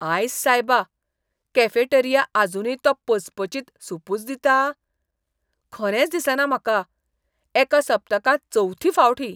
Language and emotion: Goan Konkani, disgusted